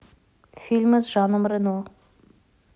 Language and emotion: Russian, neutral